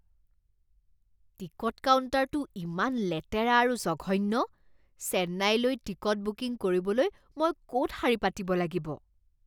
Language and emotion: Assamese, disgusted